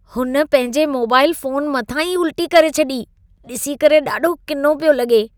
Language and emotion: Sindhi, disgusted